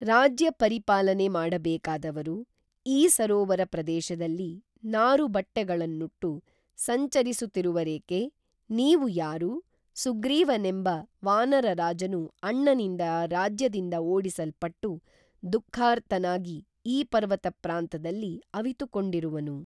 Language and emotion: Kannada, neutral